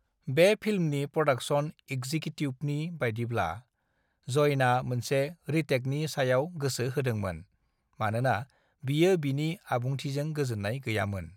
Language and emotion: Bodo, neutral